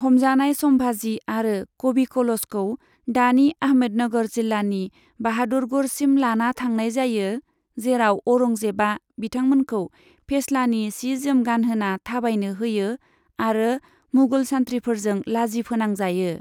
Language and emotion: Bodo, neutral